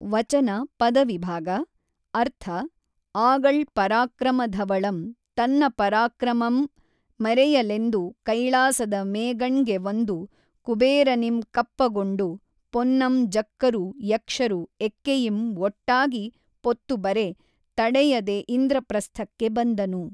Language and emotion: Kannada, neutral